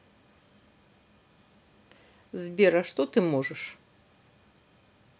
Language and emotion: Russian, neutral